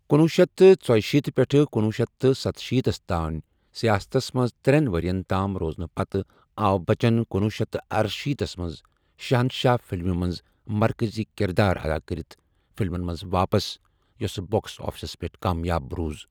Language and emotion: Kashmiri, neutral